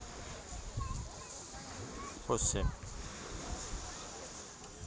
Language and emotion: Russian, neutral